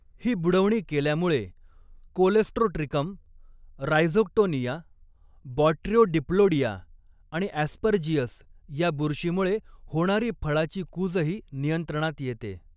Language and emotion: Marathi, neutral